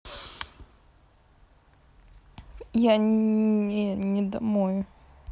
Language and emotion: Russian, sad